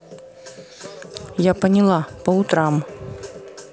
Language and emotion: Russian, neutral